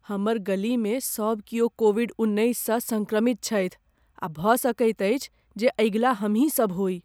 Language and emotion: Maithili, fearful